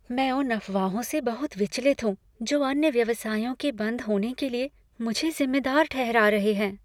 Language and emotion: Hindi, fearful